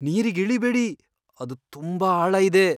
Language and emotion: Kannada, fearful